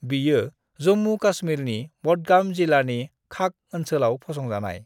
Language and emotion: Bodo, neutral